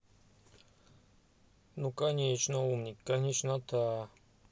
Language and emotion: Russian, neutral